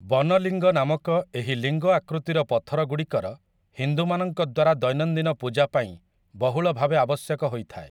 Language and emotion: Odia, neutral